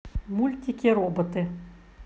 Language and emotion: Russian, neutral